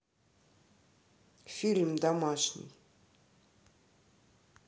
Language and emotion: Russian, neutral